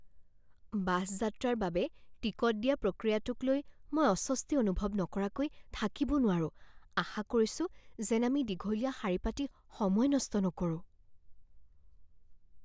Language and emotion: Assamese, fearful